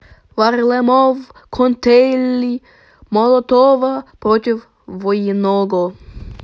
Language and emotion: Russian, positive